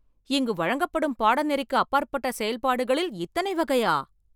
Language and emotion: Tamil, surprised